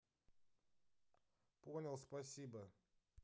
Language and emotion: Russian, neutral